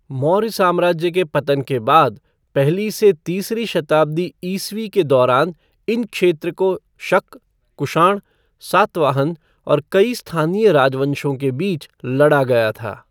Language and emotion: Hindi, neutral